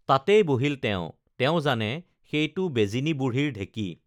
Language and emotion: Assamese, neutral